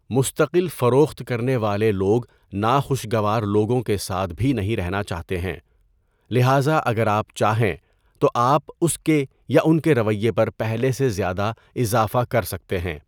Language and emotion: Urdu, neutral